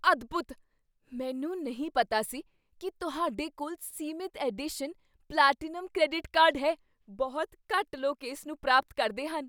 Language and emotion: Punjabi, surprised